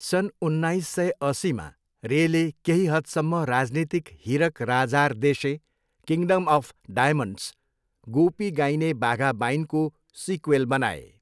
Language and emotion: Nepali, neutral